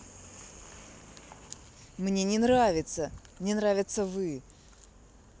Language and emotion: Russian, angry